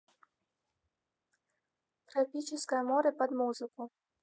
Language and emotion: Russian, neutral